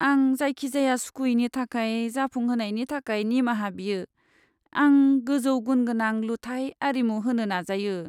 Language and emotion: Bodo, sad